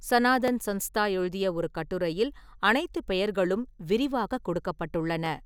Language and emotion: Tamil, neutral